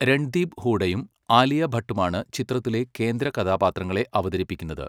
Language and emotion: Malayalam, neutral